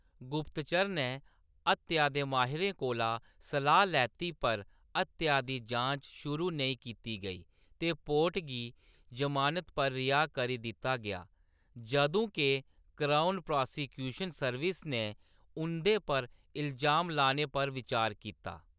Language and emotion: Dogri, neutral